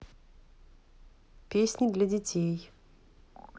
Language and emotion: Russian, neutral